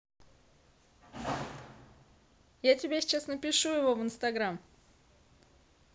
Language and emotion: Russian, neutral